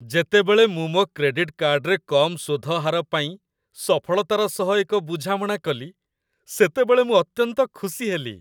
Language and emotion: Odia, happy